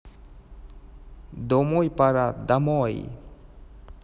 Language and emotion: Russian, neutral